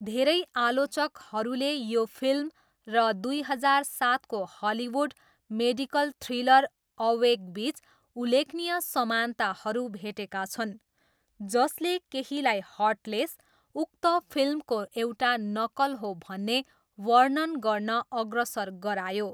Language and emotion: Nepali, neutral